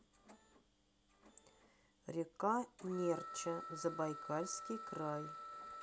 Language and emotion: Russian, neutral